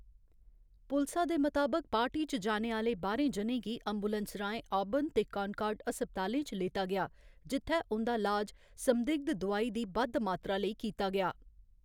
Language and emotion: Dogri, neutral